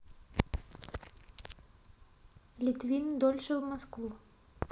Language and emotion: Russian, neutral